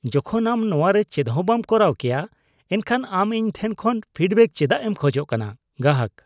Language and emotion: Santali, disgusted